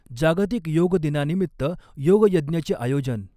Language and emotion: Marathi, neutral